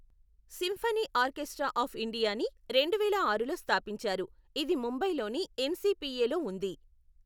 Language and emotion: Telugu, neutral